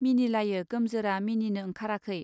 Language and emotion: Bodo, neutral